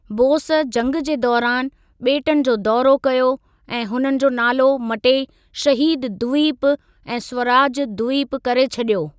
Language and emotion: Sindhi, neutral